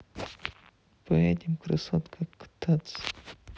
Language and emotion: Russian, neutral